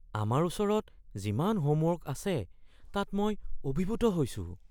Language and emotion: Assamese, fearful